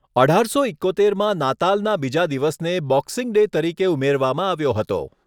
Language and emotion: Gujarati, neutral